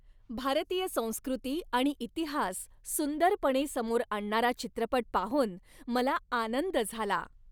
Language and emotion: Marathi, happy